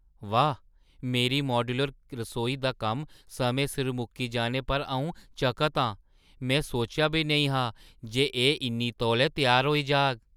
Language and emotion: Dogri, surprised